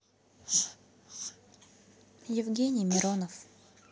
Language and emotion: Russian, neutral